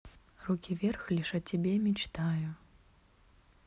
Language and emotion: Russian, neutral